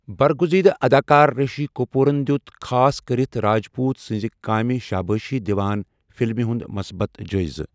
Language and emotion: Kashmiri, neutral